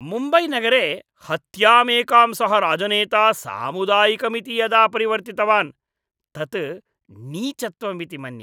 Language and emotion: Sanskrit, disgusted